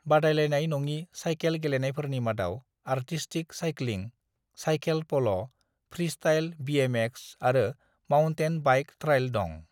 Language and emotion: Bodo, neutral